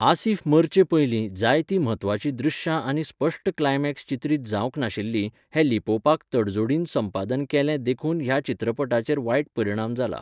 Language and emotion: Goan Konkani, neutral